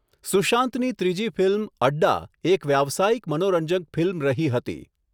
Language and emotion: Gujarati, neutral